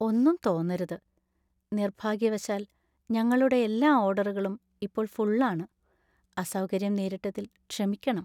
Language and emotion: Malayalam, sad